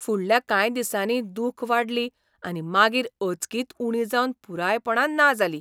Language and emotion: Goan Konkani, surprised